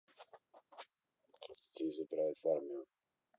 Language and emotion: Russian, neutral